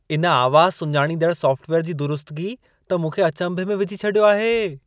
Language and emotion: Sindhi, surprised